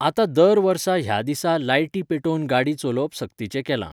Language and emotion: Goan Konkani, neutral